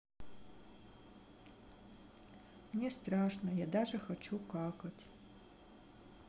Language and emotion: Russian, sad